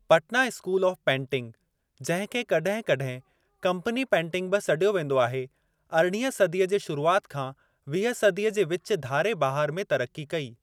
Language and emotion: Sindhi, neutral